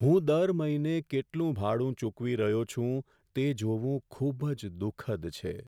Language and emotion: Gujarati, sad